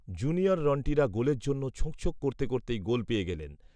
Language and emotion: Bengali, neutral